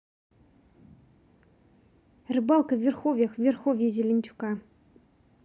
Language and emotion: Russian, neutral